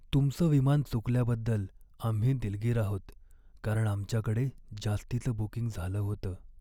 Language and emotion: Marathi, sad